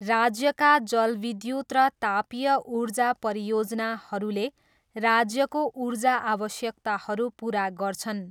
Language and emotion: Nepali, neutral